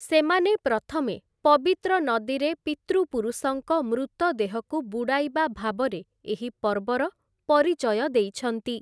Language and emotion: Odia, neutral